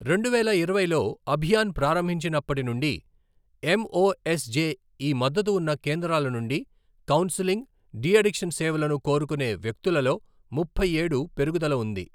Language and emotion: Telugu, neutral